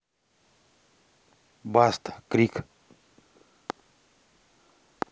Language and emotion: Russian, neutral